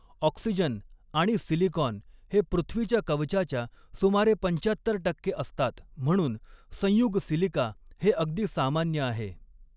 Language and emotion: Marathi, neutral